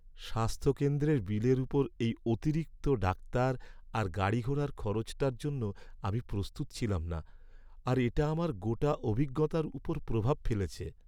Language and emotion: Bengali, sad